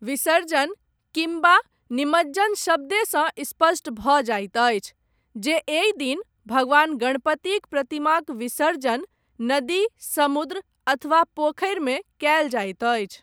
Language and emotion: Maithili, neutral